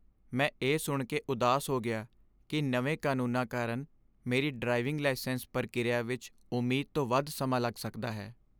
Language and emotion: Punjabi, sad